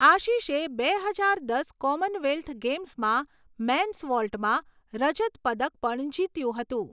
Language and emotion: Gujarati, neutral